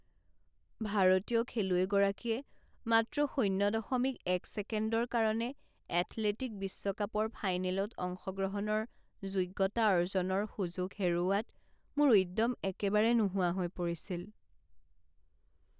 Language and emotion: Assamese, sad